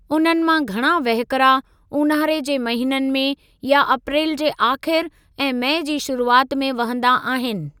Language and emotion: Sindhi, neutral